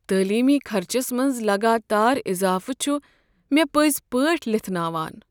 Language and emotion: Kashmiri, sad